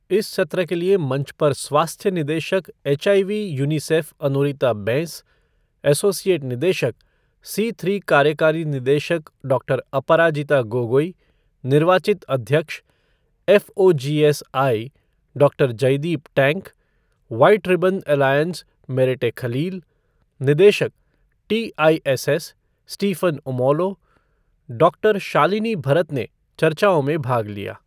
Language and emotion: Hindi, neutral